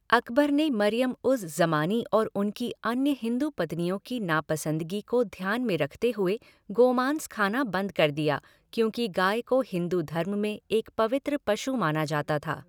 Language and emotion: Hindi, neutral